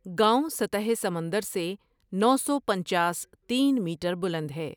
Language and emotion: Urdu, neutral